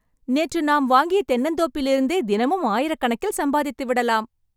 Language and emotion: Tamil, happy